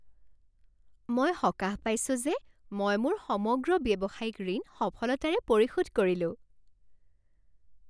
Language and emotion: Assamese, happy